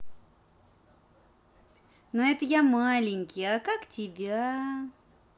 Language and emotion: Russian, positive